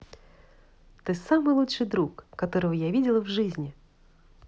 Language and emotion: Russian, positive